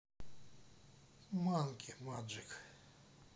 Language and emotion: Russian, neutral